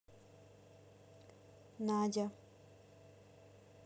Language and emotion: Russian, neutral